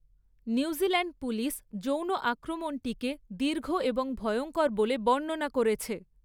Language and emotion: Bengali, neutral